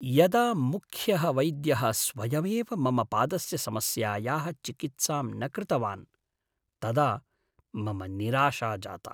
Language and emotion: Sanskrit, sad